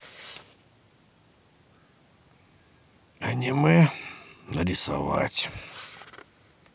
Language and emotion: Russian, neutral